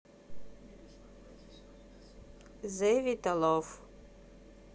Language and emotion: Russian, neutral